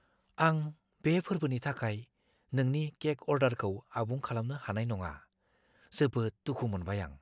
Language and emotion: Bodo, fearful